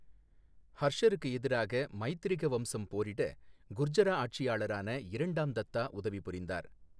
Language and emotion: Tamil, neutral